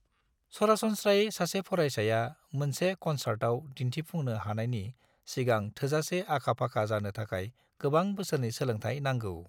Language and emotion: Bodo, neutral